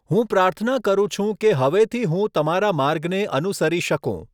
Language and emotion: Gujarati, neutral